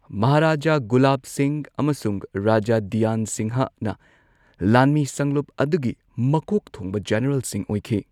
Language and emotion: Manipuri, neutral